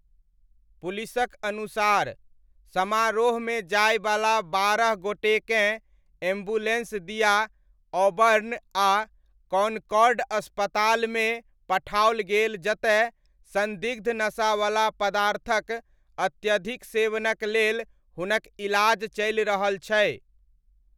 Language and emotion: Maithili, neutral